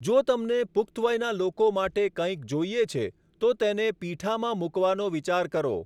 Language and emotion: Gujarati, neutral